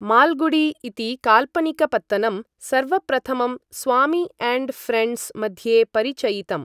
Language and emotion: Sanskrit, neutral